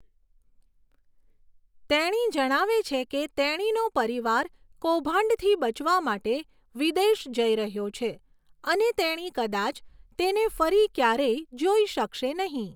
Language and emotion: Gujarati, neutral